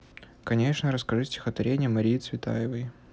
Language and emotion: Russian, neutral